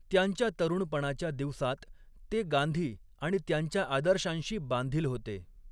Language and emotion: Marathi, neutral